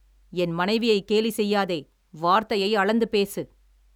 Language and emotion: Tamil, angry